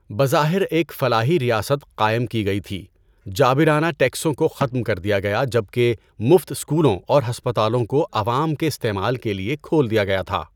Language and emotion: Urdu, neutral